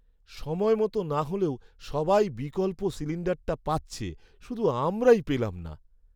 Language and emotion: Bengali, sad